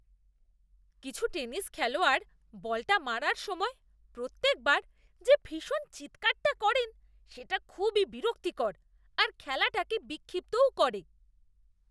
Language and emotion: Bengali, disgusted